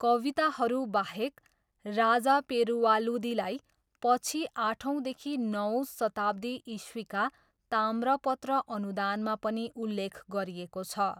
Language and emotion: Nepali, neutral